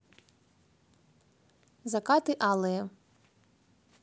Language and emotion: Russian, neutral